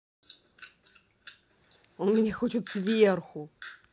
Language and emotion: Russian, neutral